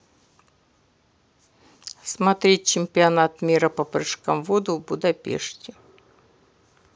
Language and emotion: Russian, neutral